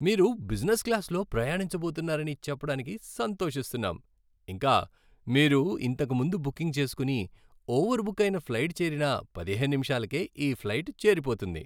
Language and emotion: Telugu, happy